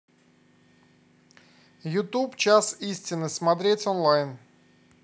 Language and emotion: Russian, neutral